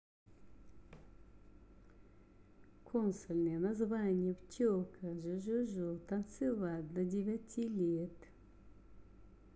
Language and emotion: Russian, neutral